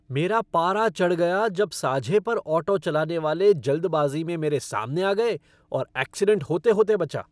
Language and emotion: Hindi, angry